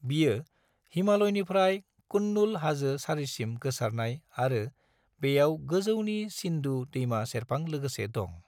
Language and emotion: Bodo, neutral